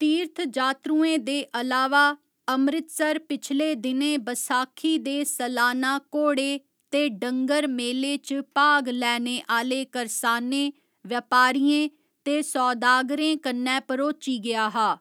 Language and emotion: Dogri, neutral